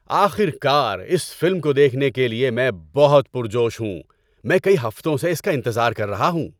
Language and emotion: Urdu, happy